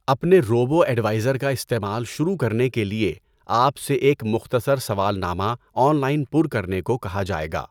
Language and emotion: Urdu, neutral